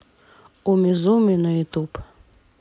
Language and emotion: Russian, neutral